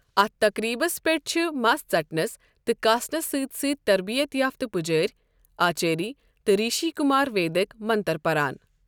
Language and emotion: Kashmiri, neutral